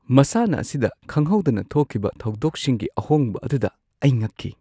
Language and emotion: Manipuri, surprised